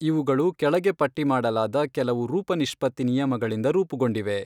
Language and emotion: Kannada, neutral